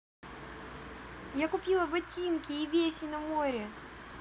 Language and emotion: Russian, positive